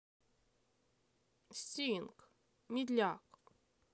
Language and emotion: Russian, neutral